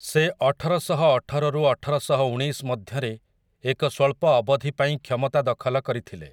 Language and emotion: Odia, neutral